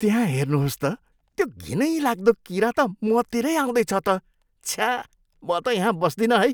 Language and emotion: Nepali, disgusted